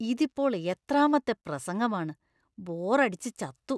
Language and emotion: Malayalam, disgusted